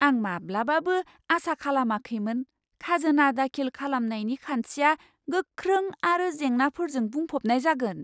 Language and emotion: Bodo, surprised